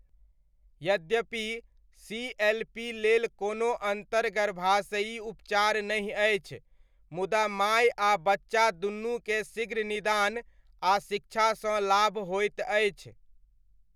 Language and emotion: Maithili, neutral